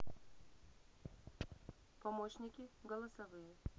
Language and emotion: Russian, neutral